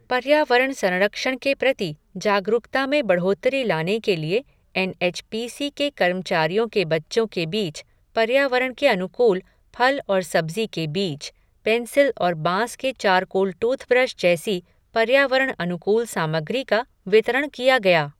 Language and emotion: Hindi, neutral